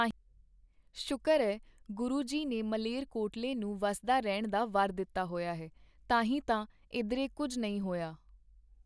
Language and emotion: Punjabi, neutral